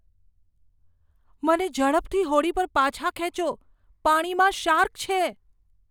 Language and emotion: Gujarati, fearful